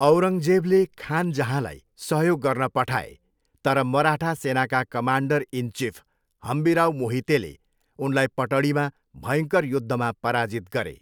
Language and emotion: Nepali, neutral